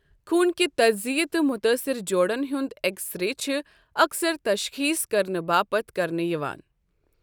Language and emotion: Kashmiri, neutral